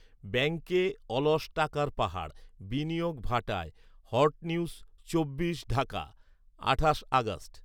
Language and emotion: Bengali, neutral